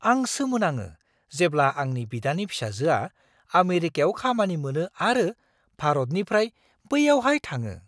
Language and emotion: Bodo, surprised